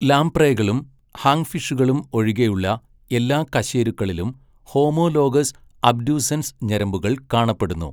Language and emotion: Malayalam, neutral